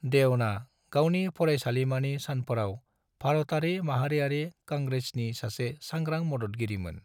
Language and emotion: Bodo, neutral